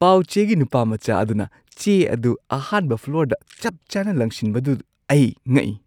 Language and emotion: Manipuri, surprised